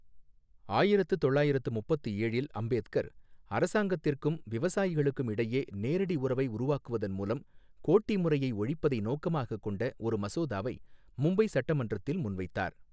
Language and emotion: Tamil, neutral